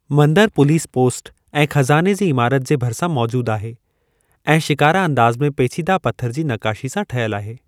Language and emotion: Sindhi, neutral